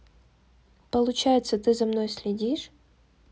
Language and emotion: Russian, neutral